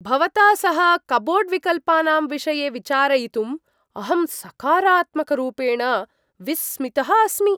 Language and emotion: Sanskrit, surprised